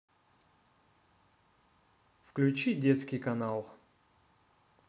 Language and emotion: Russian, neutral